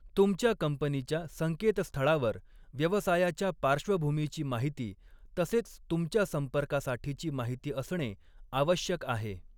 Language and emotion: Marathi, neutral